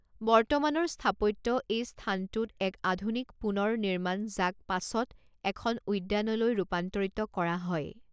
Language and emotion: Assamese, neutral